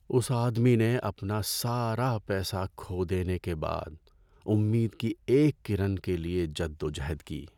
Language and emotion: Urdu, sad